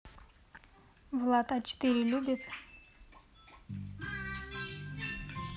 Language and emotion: Russian, neutral